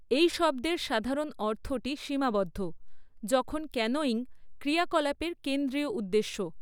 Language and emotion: Bengali, neutral